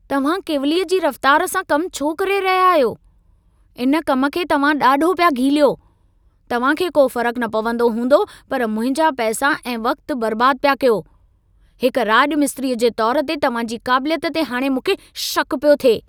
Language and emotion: Sindhi, angry